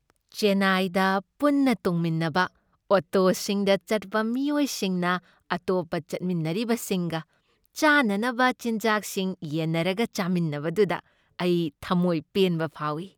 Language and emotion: Manipuri, happy